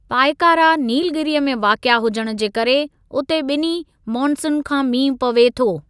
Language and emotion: Sindhi, neutral